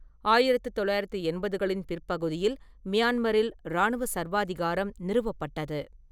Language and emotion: Tamil, neutral